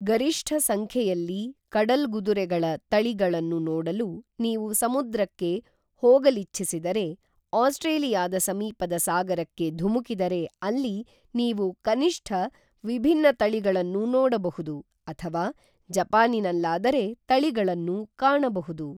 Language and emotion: Kannada, neutral